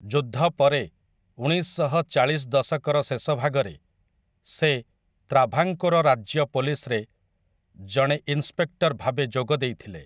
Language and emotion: Odia, neutral